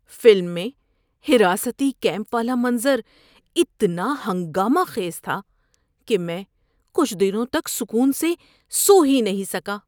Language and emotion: Urdu, disgusted